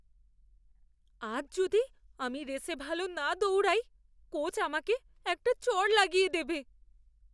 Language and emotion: Bengali, fearful